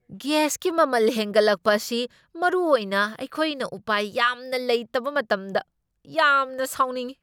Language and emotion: Manipuri, angry